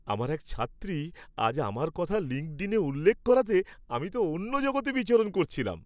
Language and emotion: Bengali, happy